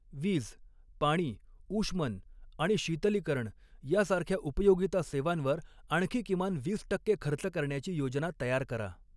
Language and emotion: Marathi, neutral